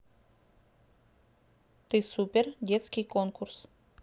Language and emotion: Russian, neutral